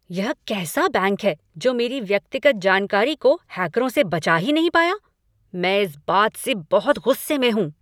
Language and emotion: Hindi, angry